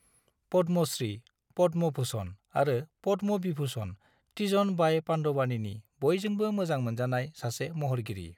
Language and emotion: Bodo, neutral